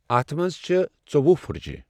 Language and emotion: Kashmiri, neutral